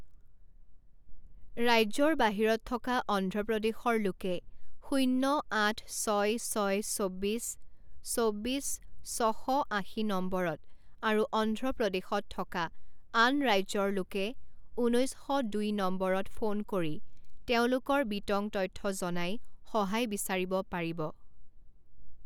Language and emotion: Assamese, neutral